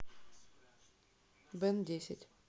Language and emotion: Russian, neutral